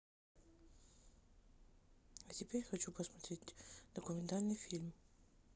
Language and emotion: Russian, neutral